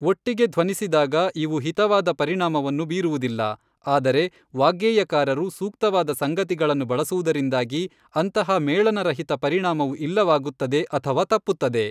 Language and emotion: Kannada, neutral